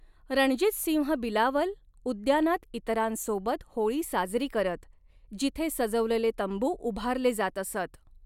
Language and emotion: Marathi, neutral